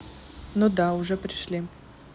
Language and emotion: Russian, neutral